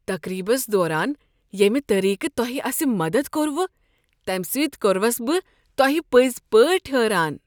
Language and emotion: Kashmiri, surprised